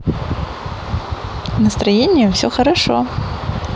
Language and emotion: Russian, positive